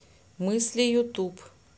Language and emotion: Russian, neutral